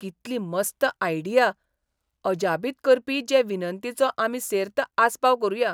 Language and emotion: Goan Konkani, surprised